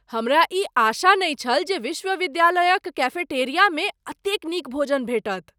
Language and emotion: Maithili, surprised